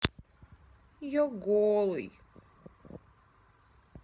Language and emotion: Russian, sad